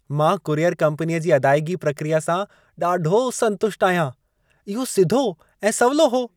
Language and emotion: Sindhi, happy